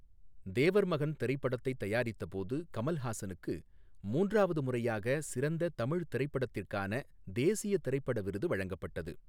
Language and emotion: Tamil, neutral